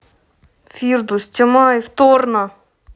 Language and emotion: Russian, angry